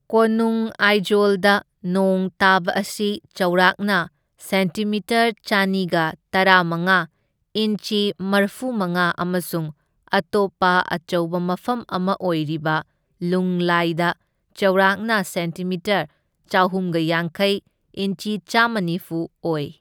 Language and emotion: Manipuri, neutral